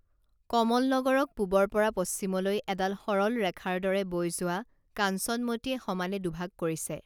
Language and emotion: Assamese, neutral